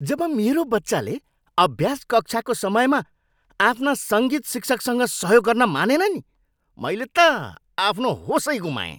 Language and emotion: Nepali, angry